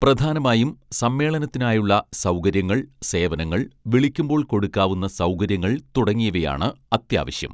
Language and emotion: Malayalam, neutral